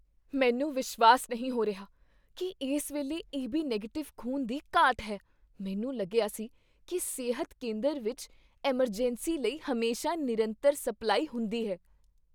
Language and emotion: Punjabi, surprised